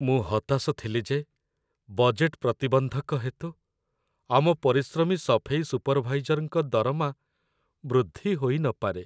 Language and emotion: Odia, sad